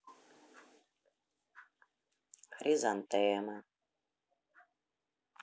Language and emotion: Russian, sad